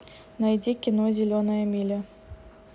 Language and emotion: Russian, neutral